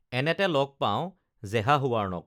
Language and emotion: Assamese, neutral